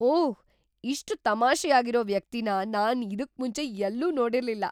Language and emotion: Kannada, surprised